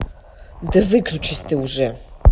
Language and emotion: Russian, angry